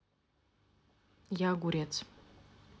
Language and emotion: Russian, neutral